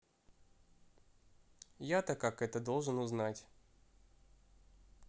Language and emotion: Russian, neutral